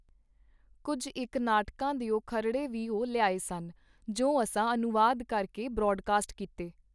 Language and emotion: Punjabi, neutral